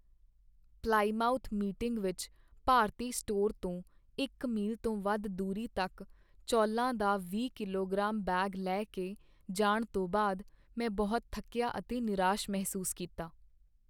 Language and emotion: Punjabi, sad